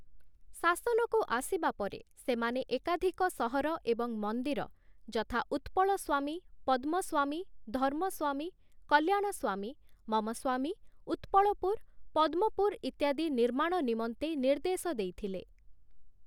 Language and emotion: Odia, neutral